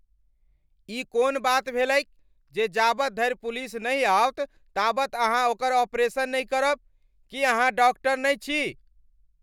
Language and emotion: Maithili, angry